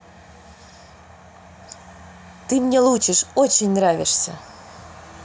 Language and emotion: Russian, positive